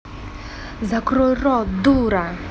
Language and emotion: Russian, angry